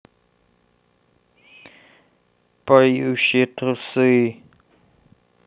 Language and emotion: Russian, sad